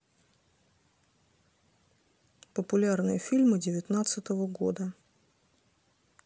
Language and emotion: Russian, neutral